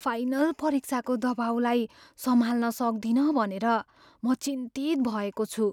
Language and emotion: Nepali, fearful